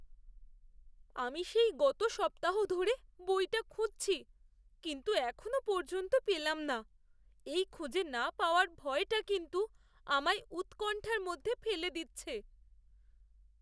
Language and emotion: Bengali, fearful